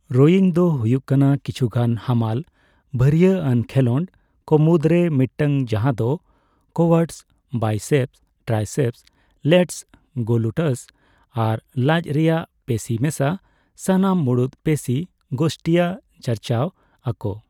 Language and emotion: Santali, neutral